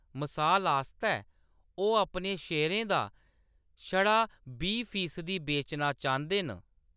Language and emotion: Dogri, neutral